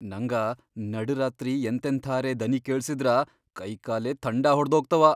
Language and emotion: Kannada, fearful